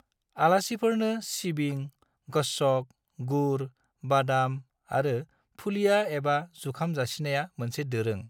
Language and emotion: Bodo, neutral